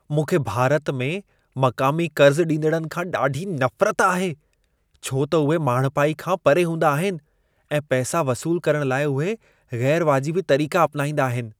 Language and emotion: Sindhi, disgusted